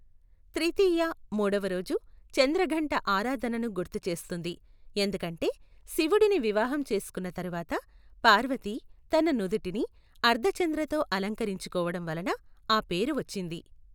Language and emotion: Telugu, neutral